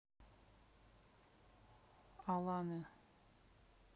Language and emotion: Russian, neutral